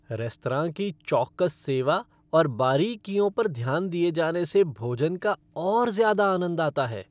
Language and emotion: Hindi, happy